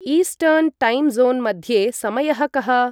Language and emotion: Sanskrit, neutral